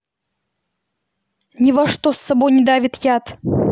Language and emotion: Russian, angry